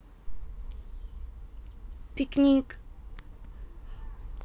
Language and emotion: Russian, neutral